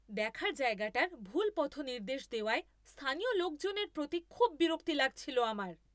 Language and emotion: Bengali, angry